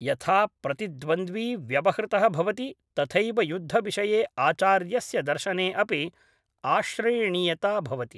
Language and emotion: Sanskrit, neutral